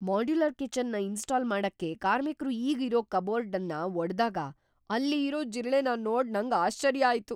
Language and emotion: Kannada, surprised